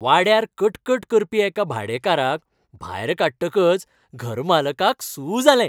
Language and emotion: Goan Konkani, happy